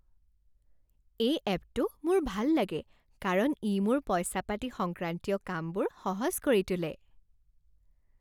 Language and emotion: Assamese, happy